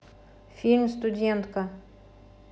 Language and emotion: Russian, neutral